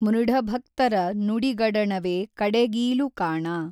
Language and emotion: Kannada, neutral